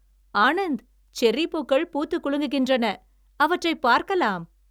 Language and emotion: Tamil, happy